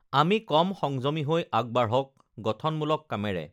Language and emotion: Assamese, neutral